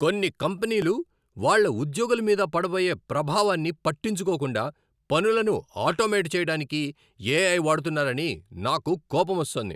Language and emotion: Telugu, angry